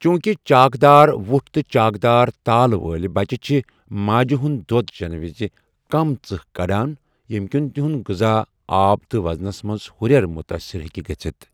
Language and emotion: Kashmiri, neutral